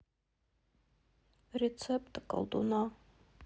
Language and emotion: Russian, sad